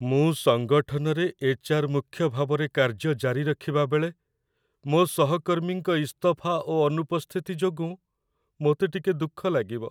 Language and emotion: Odia, sad